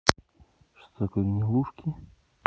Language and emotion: Russian, neutral